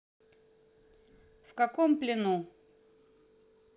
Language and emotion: Russian, neutral